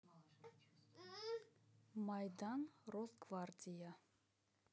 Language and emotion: Russian, neutral